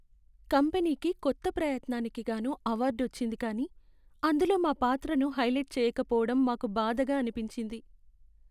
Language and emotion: Telugu, sad